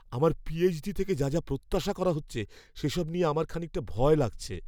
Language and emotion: Bengali, fearful